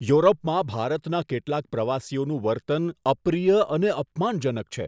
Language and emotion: Gujarati, disgusted